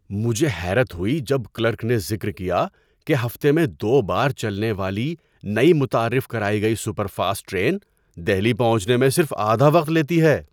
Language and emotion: Urdu, surprised